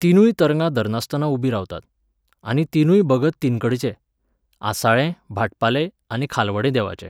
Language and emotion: Goan Konkani, neutral